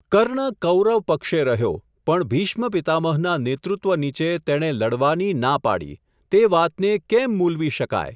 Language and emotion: Gujarati, neutral